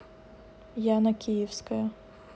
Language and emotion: Russian, neutral